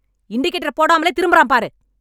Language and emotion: Tamil, angry